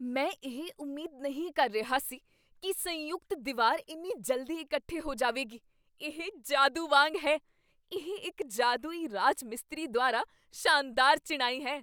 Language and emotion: Punjabi, surprised